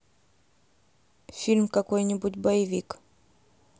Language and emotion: Russian, neutral